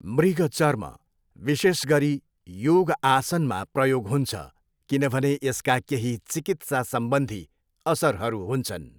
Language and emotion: Nepali, neutral